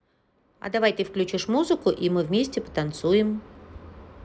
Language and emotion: Russian, positive